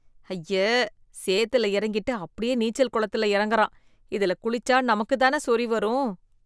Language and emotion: Tamil, disgusted